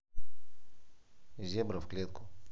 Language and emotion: Russian, neutral